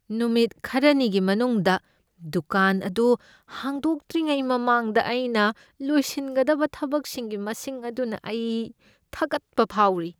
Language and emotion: Manipuri, fearful